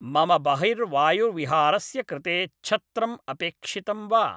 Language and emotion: Sanskrit, neutral